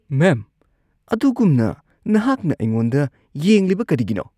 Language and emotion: Manipuri, disgusted